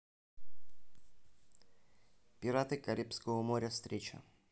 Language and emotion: Russian, neutral